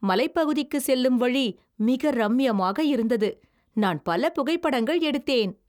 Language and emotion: Tamil, happy